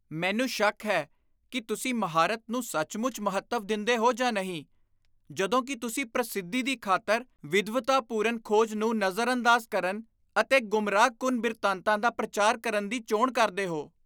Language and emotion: Punjabi, disgusted